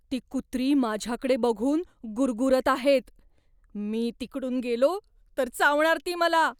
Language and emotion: Marathi, fearful